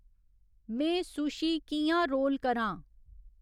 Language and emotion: Dogri, neutral